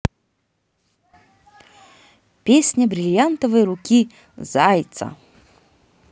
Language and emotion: Russian, positive